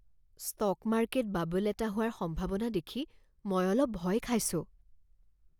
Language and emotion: Assamese, fearful